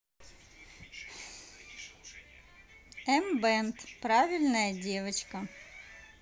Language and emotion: Russian, neutral